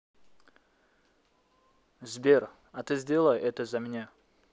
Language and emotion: Russian, neutral